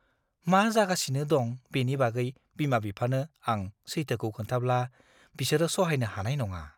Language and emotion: Bodo, fearful